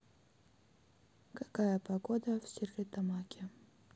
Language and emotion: Russian, sad